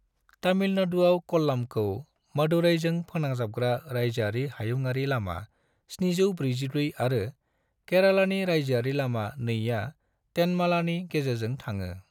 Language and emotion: Bodo, neutral